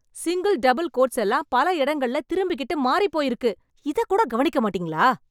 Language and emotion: Tamil, angry